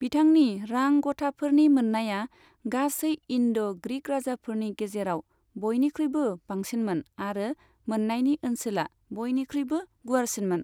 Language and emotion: Bodo, neutral